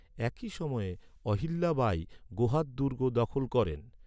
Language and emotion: Bengali, neutral